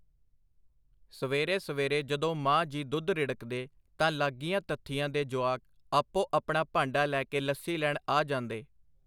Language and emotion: Punjabi, neutral